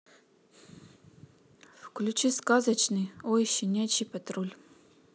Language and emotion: Russian, neutral